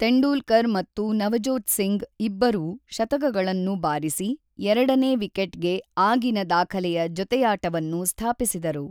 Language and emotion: Kannada, neutral